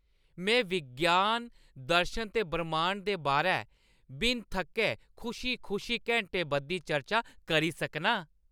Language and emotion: Dogri, happy